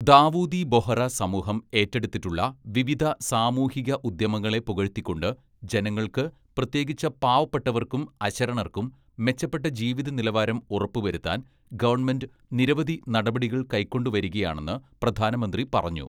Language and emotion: Malayalam, neutral